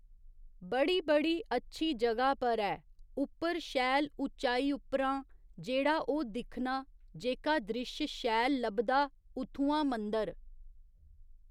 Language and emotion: Dogri, neutral